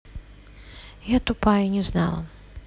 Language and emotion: Russian, sad